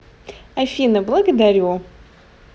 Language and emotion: Russian, positive